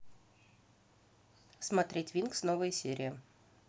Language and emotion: Russian, neutral